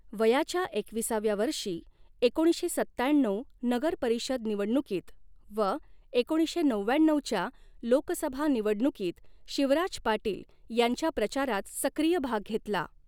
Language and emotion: Marathi, neutral